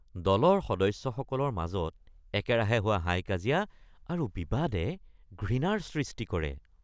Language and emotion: Assamese, disgusted